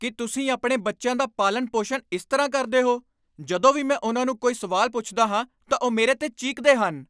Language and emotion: Punjabi, angry